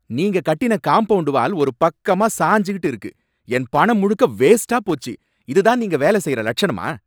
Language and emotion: Tamil, angry